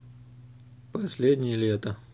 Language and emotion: Russian, neutral